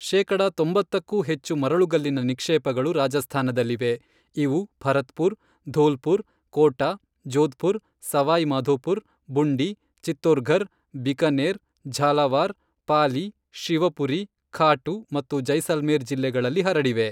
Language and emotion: Kannada, neutral